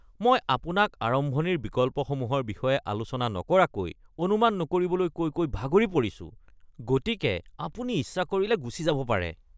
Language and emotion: Assamese, disgusted